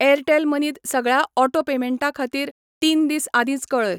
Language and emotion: Goan Konkani, neutral